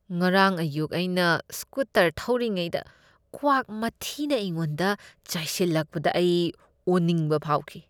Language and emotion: Manipuri, disgusted